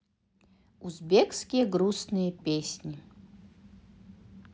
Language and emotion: Russian, positive